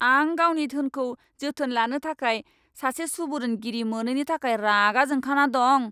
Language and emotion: Bodo, angry